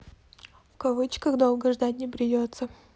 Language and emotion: Russian, neutral